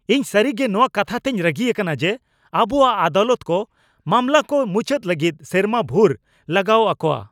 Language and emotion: Santali, angry